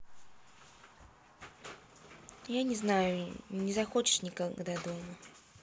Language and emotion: Russian, neutral